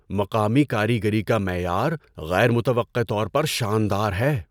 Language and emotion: Urdu, surprised